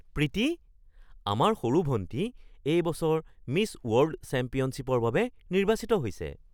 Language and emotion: Assamese, surprised